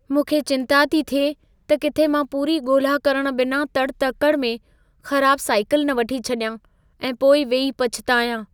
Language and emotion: Sindhi, fearful